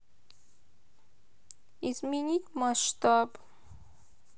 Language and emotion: Russian, sad